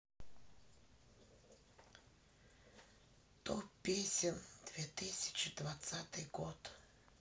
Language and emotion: Russian, sad